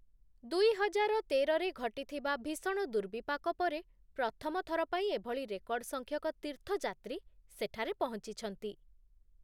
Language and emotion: Odia, neutral